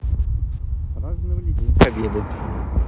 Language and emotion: Russian, neutral